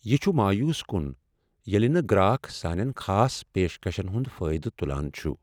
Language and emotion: Kashmiri, sad